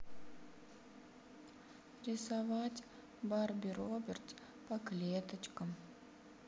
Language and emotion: Russian, sad